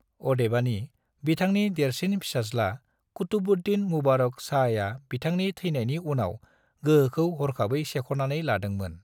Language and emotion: Bodo, neutral